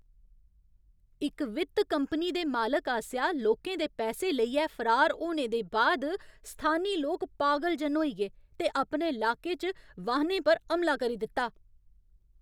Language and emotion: Dogri, angry